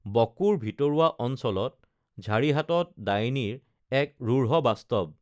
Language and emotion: Assamese, neutral